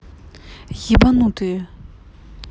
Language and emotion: Russian, angry